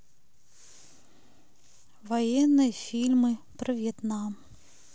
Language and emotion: Russian, sad